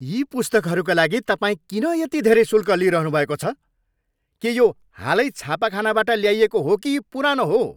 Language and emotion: Nepali, angry